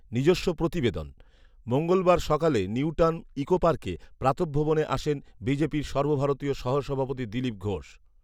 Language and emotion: Bengali, neutral